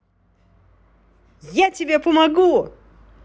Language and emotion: Russian, positive